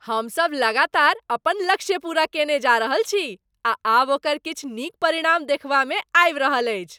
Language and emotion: Maithili, happy